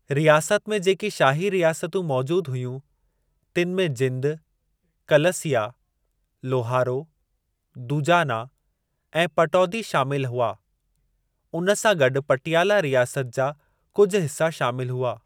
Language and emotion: Sindhi, neutral